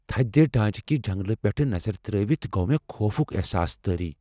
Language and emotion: Kashmiri, fearful